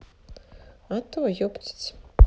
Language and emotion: Russian, neutral